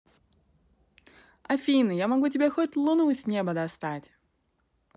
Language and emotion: Russian, positive